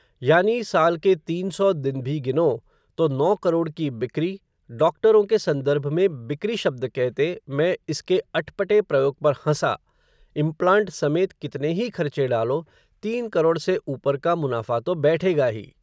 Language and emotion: Hindi, neutral